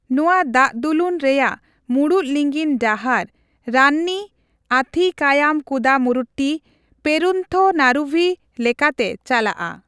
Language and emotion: Santali, neutral